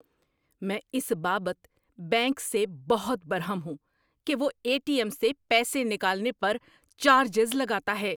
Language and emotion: Urdu, angry